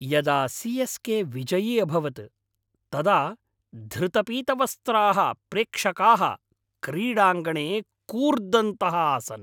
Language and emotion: Sanskrit, happy